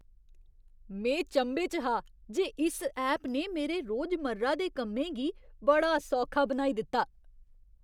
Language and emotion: Dogri, surprised